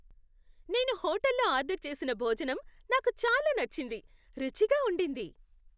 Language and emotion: Telugu, happy